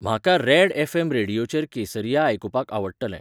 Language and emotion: Goan Konkani, neutral